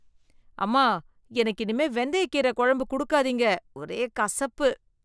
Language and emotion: Tamil, disgusted